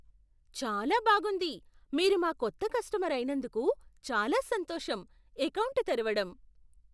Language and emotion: Telugu, surprised